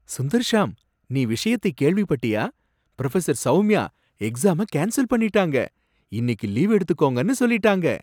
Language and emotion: Tamil, surprised